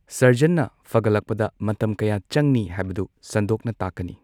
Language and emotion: Manipuri, neutral